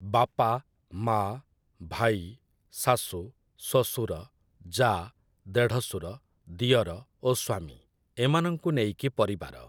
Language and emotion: Odia, neutral